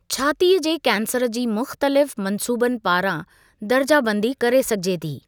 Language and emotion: Sindhi, neutral